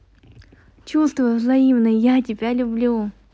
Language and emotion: Russian, positive